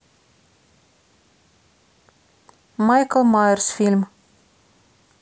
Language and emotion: Russian, neutral